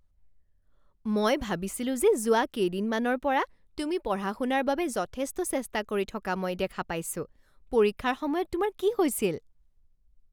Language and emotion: Assamese, surprised